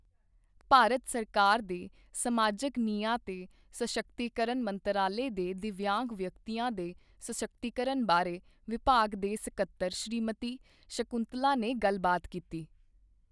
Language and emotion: Punjabi, neutral